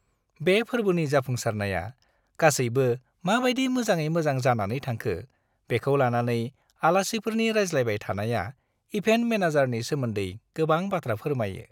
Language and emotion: Bodo, happy